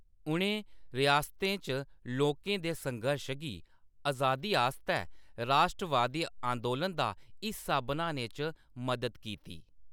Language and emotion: Dogri, neutral